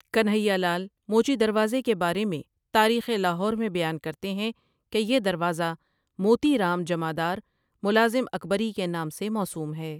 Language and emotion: Urdu, neutral